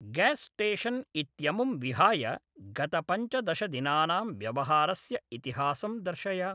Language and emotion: Sanskrit, neutral